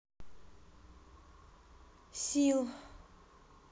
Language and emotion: Russian, sad